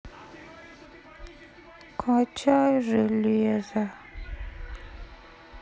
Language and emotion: Russian, sad